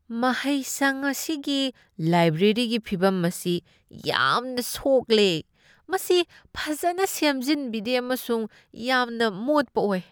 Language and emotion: Manipuri, disgusted